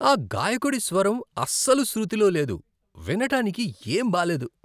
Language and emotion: Telugu, disgusted